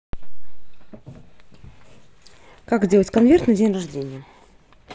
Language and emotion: Russian, neutral